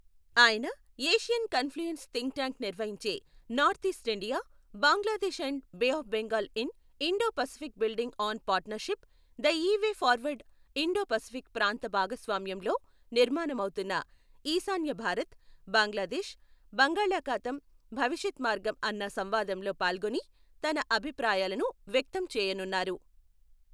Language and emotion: Telugu, neutral